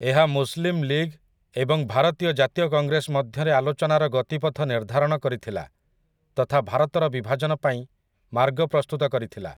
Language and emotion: Odia, neutral